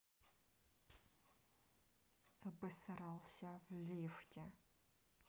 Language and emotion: Russian, neutral